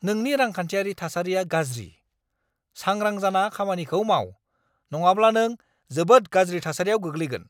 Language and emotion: Bodo, angry